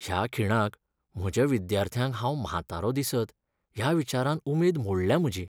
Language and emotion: Goan Konkani, sad